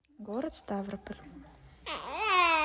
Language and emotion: Russian, neutral